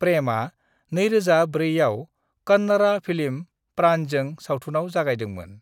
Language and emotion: Bodo, neutral